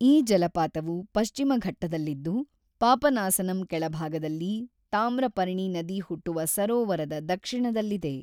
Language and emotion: Kannada, neutral